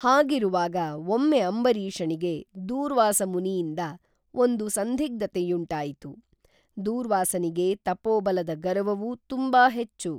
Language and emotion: Kannada, neutral